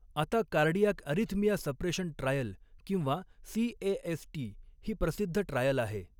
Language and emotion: Marathi, neutral